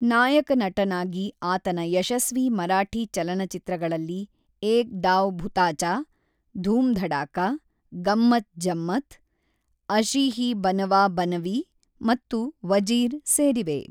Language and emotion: Kannada, neutral